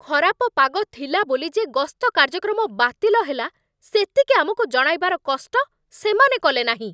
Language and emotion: Odia, angry